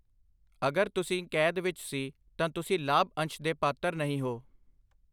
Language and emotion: Punjabi, neutral